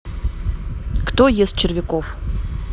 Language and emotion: Russian, neutral